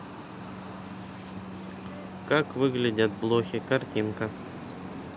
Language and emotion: Russian, neutral